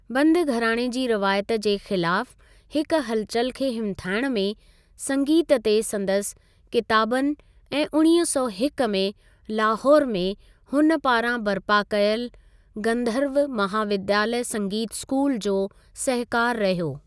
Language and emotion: Sindhi, neutral